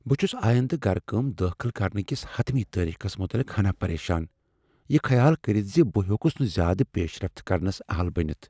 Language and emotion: Kashmiri, fearful